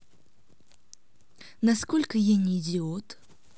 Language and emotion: Russian, neutral